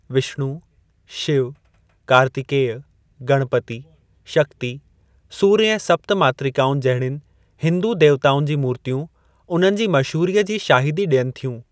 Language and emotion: Sindhi, neutral